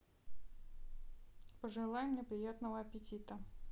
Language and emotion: Russian, neutral